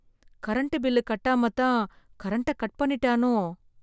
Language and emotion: Tamil, fearful